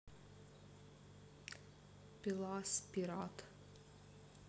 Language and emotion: Russian, neutral